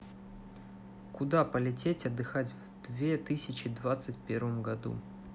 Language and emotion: Russian, neutral